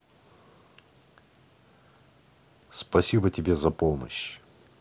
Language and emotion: Russian, neutral